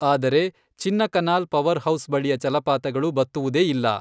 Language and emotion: Kannada, neutral